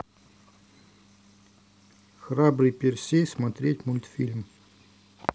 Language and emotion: Russian, neutral